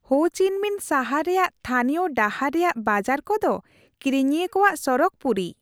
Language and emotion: Santali, happy